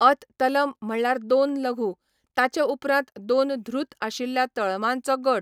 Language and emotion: Goan Konkani, neutral